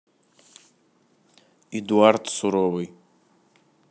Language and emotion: Russian, neutral